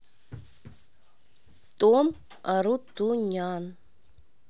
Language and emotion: Russian, neutral